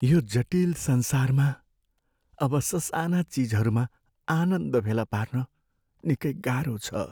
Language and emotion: Nepali, sad